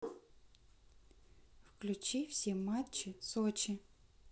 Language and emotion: Russian, neutral